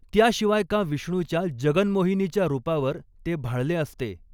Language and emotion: Marathi, neutral